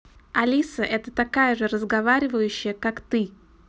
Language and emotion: Russian, neutral